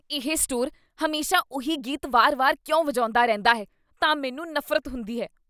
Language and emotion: Punjabi, disgusted